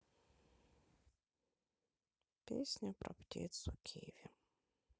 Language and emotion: Russian, sad